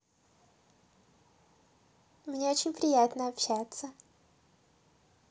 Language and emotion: Russian, positive